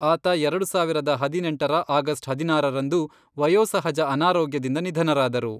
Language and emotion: Kannada, neutral